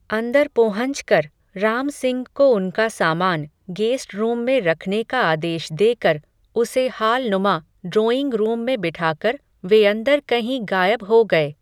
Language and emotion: Hindi, neutral